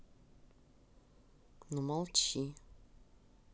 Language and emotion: Russian, neutral